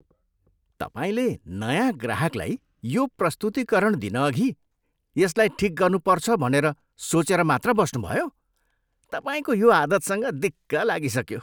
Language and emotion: Nepali, disgusted